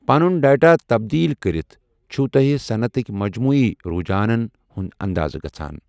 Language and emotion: Kashmiri, neutral